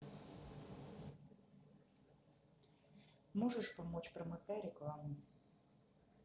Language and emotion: Russian, neutral